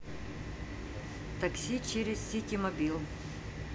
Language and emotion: Russian, neutral